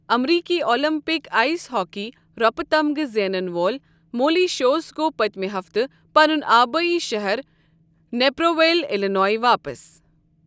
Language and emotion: Kashmiri, neutral